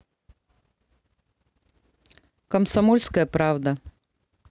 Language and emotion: Russian, neutral